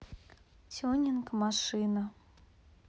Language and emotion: Russian, neutral